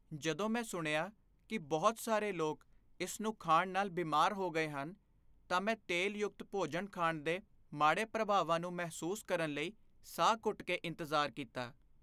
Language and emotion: Punjabi, fearful